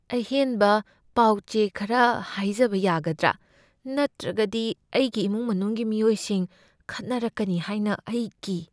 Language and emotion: Manipuri, fearful